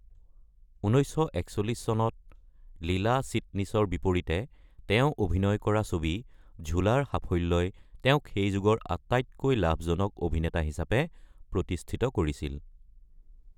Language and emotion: Assamese, neutral